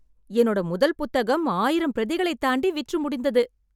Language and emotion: Tamil, happy